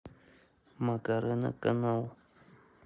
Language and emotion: Russian, neutral